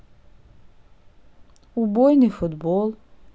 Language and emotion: Russian, neutral